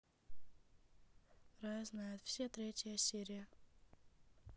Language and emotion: Russian, neutral